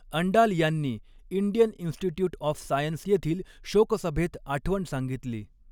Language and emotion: Marathi, neutral